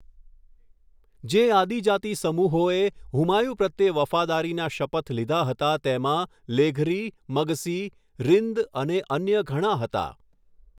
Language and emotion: Gujarati, neutral